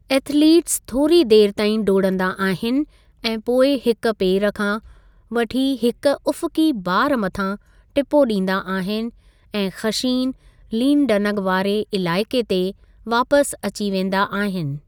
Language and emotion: Sindhi, neutral